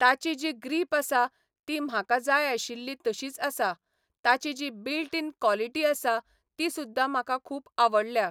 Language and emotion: Goan Konkani, neutral